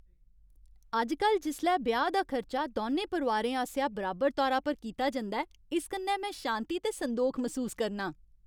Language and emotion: Dogri, happy